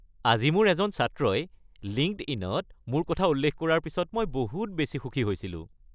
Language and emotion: Assamese, happy